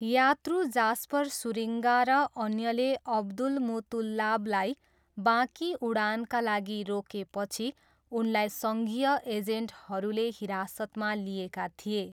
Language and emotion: Nepali, neutral